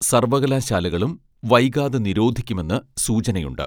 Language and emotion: Malayalam, neutral